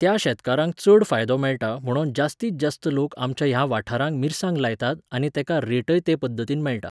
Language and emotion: Goan Konkani, neutral